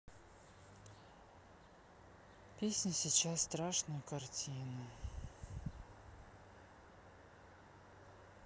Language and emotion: Russian, sad